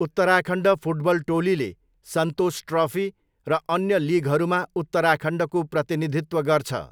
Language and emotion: Nepali, neutral